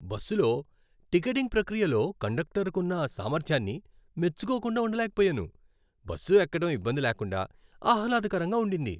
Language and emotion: Telugu, happy